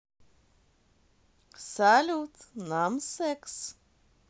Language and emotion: Russian, positive